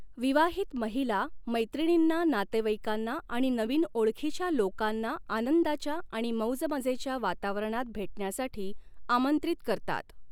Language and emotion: Marathi, neutral